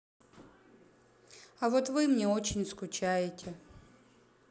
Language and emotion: Russian, sad